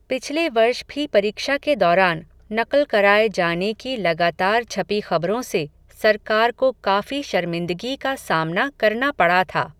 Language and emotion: Hindi, neutral